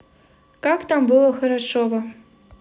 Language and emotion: Russian, positive